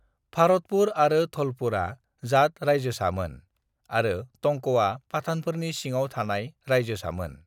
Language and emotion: Bodo, neutral